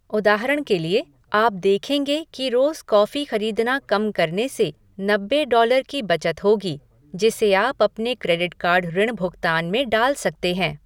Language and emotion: Hindi, neutral